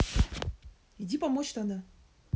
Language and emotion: Russian, neutral